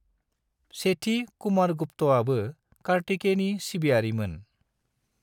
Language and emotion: Bodo, neutral